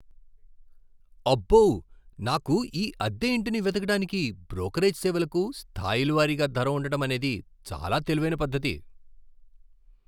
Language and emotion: Telugu, surprised